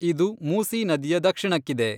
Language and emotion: Kannada, neutral